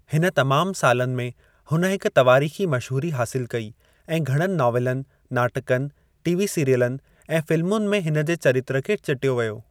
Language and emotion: Sindhi, neutral